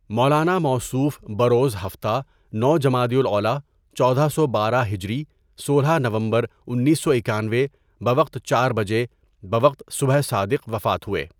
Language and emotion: Urdu, neutral